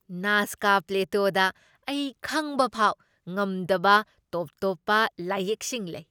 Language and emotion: Manipuri, surprised